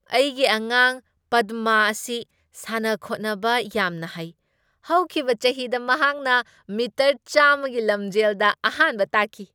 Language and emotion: Manipuri, happy